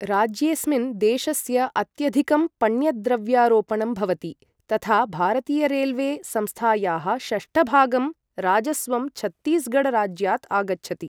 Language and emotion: Sanskrit, neutral